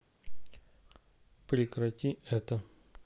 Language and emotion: Russian, neutral